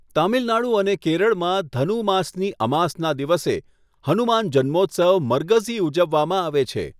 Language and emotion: Gujarati, neutral